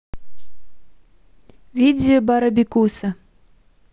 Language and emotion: Russian, neutral